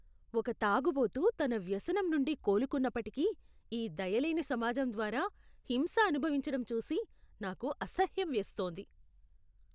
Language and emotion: Telugu, disgusted